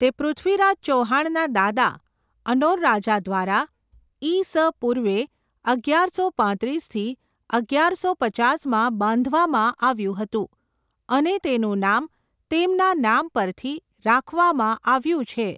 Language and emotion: Gujarati, neutral